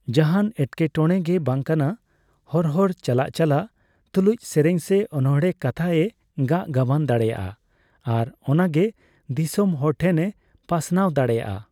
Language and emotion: Santali, neutral